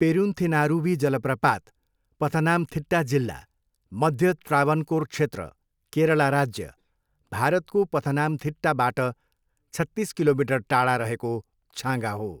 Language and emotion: Nepali, neutral